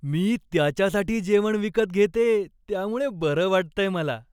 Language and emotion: Marathi, happy